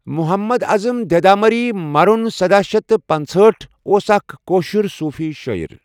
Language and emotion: Kashmiri, neutral